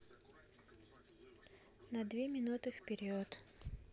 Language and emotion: Russian, neutral